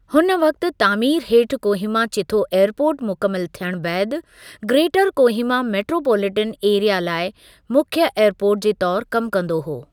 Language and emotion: Sindhi, neutral